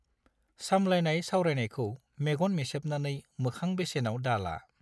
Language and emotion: Bodo, neutral